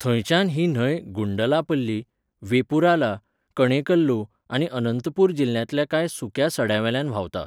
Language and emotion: Goan Konkani, neutral